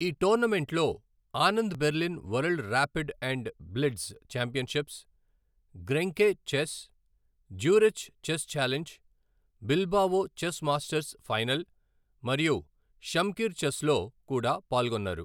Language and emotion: Telugu, neutral